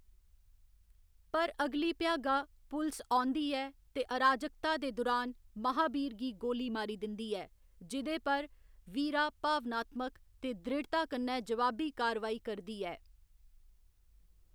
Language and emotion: Dogri, neutral